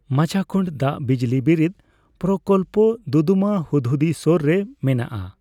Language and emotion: Santali, neutral